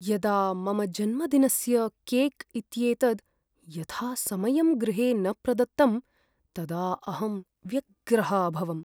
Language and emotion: Sanskrit, sad